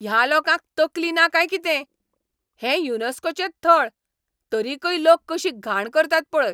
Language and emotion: Goan Konkani, angry